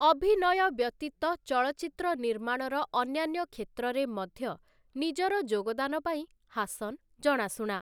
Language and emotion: Odia, neutral